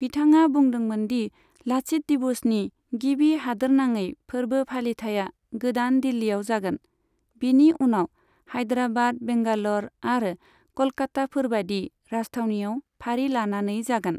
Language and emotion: Bodo, neutral